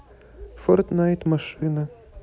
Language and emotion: Russian, neutral